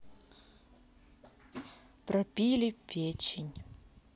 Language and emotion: Russian, neutral